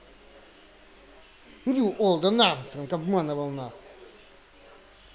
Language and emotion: Russian, angry